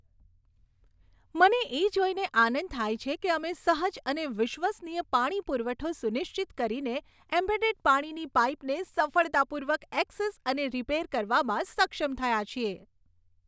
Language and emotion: Gujarati, happy